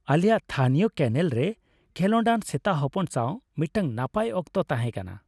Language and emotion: Santali, happy